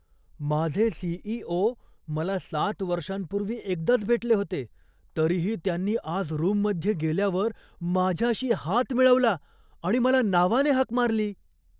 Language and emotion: Marathi, surprised